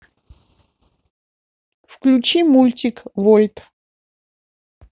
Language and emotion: Russian, neutral